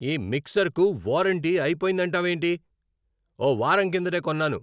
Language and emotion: Telugu, angry